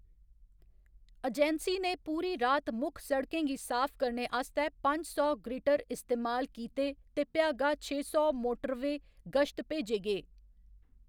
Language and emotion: Dogri, neutral